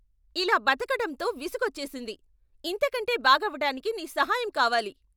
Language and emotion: Telugu, angry